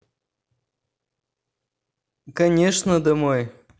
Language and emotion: Russian, neutral